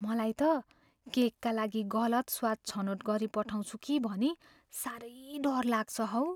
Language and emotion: Nepali, fearful